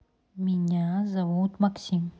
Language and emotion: Russian, neutral